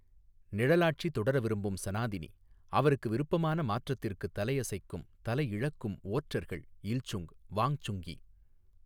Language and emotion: Tamil, neutral